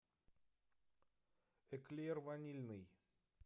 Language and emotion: Russian, neutral